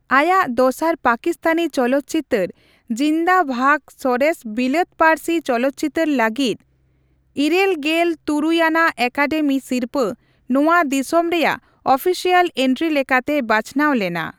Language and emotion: Santali, neutral